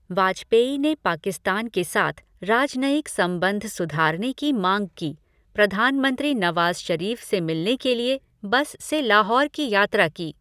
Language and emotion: Hindi, neutral